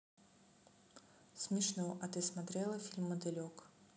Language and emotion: Russian, neutral